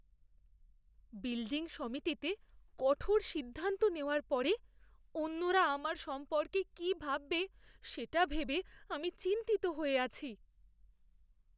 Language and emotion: Bengali, fearful